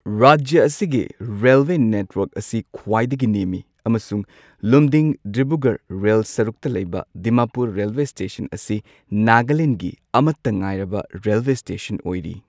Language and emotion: Manipuri, neutral